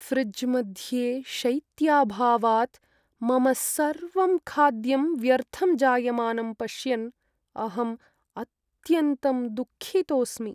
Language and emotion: Sanskrit, sad